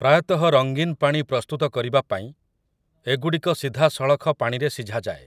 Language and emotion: Odia, neutral